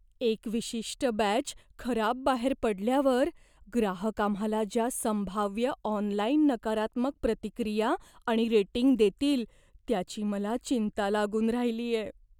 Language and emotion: Marathi, fearful